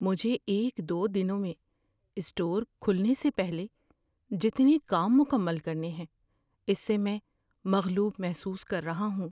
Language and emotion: Urdu, fearful